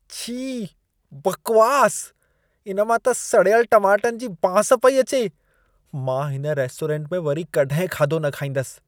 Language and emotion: Sindhi, disgusted